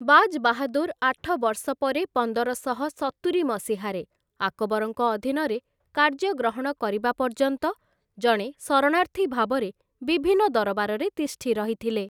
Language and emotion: Odia, neutral